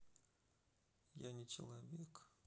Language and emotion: Russian, sad